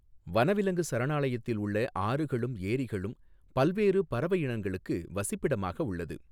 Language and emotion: Tamil, neutral